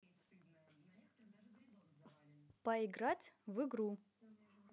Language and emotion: Russian, positive